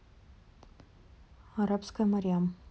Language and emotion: Russian, neutral